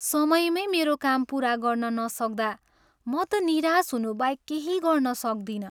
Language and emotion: Nepali, sad